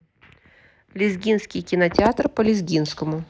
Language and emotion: Russian, neutral